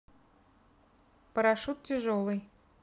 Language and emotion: Russian, neutral